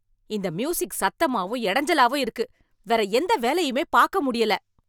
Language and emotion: Tamil, angry